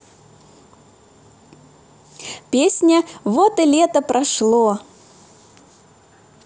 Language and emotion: Russian, positive